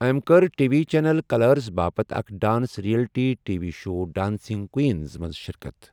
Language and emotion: Kashmiri, neutral